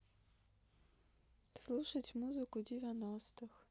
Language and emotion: Russian, sad